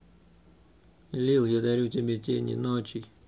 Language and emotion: Russian, neutral